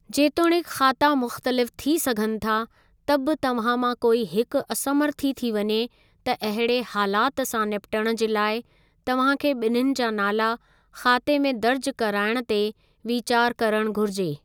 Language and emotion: Sindhi, neutral